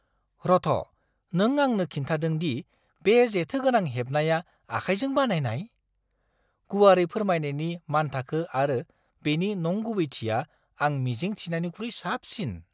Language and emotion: Bodo, surprised